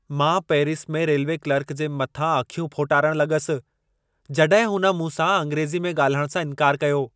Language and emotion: Sindhi, angry